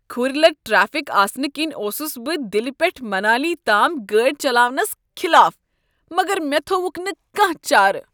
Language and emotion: Kashmiri, disgusted